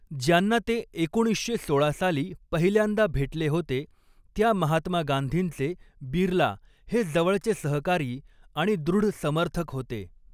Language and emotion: Marathi, neutral